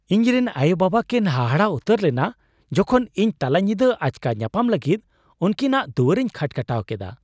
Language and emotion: Santali, surprised